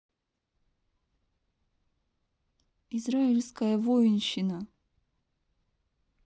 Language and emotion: Russian, neutral